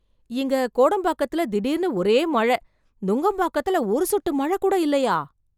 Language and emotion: Tamil, surprised